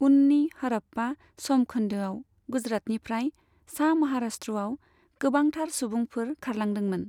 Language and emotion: Bodo, neutral